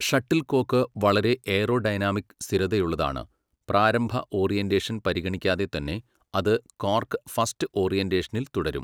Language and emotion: Malayalam, neutral